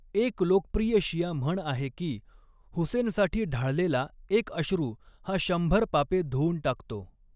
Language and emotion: Marathi, neutral